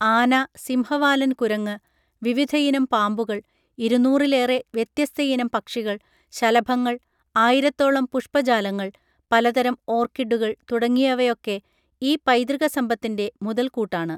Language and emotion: Malayalam, neutral